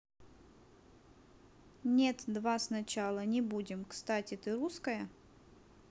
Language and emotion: Russian, neutral